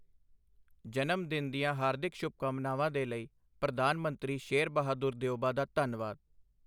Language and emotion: Punjabi, neutral